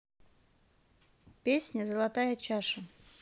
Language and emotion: Russian, neutral